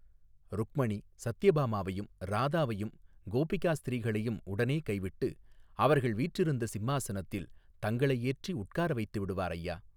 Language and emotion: Tamil, neutral